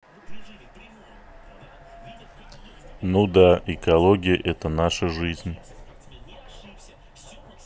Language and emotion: Russian, neutral